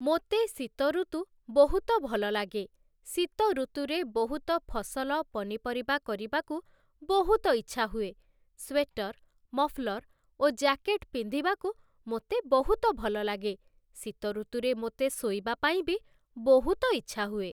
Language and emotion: Odia, neutral